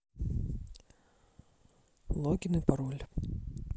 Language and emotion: Russian, neutral